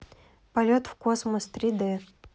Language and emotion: Russian, neutral